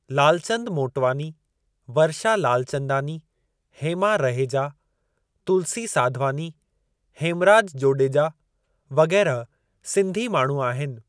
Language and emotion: Sindhi, neutral